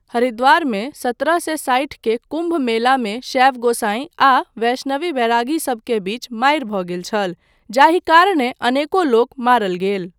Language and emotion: Maithili, neutral